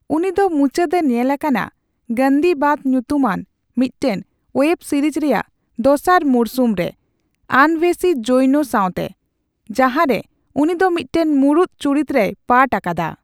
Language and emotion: Santali, neutral